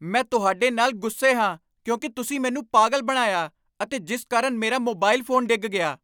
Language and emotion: Punjabi, angry